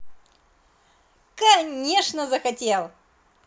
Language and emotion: Russian, positive